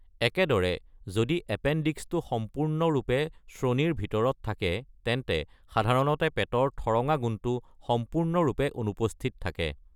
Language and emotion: Assamese, neutral